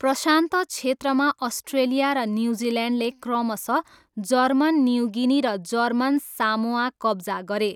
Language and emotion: Nepali, neutral